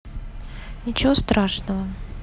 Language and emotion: Russian, neutral